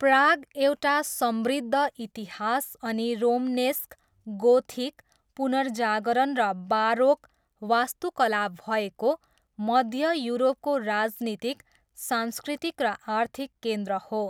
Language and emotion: Nepali, neutral